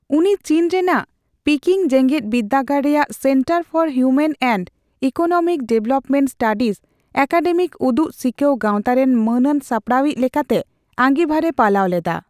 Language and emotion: Santali, neutral